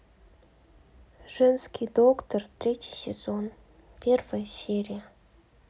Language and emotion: Russian, sad